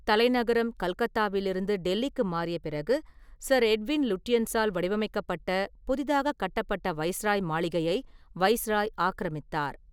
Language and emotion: Tamil, neutral